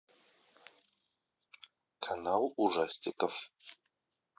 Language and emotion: Russian, neutral